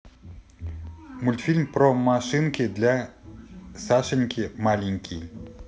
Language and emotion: Russian, positive